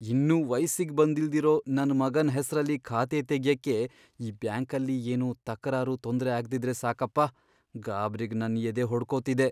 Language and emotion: Kannada, fearful